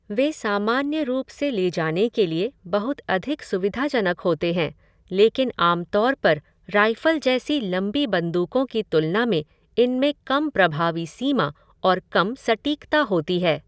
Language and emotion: Hindi, neutral